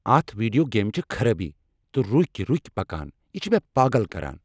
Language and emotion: Kashmiri, angry